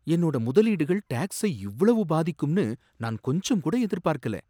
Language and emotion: Tamil, surprised